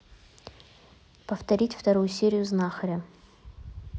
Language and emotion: Russian, neutral